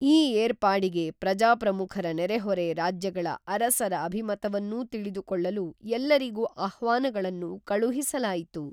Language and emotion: Kannada, neutral